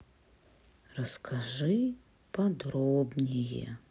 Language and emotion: Russian, sad